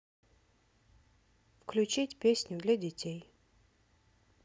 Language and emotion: Russian, neutral